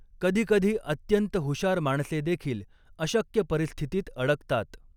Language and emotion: Marathi, neutral